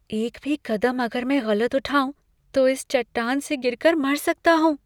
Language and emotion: Hindi, fearful